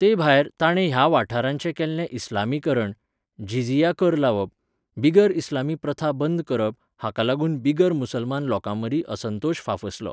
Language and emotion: Goan Konkani, neutral